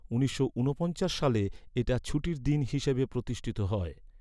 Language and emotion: Bengali, neutral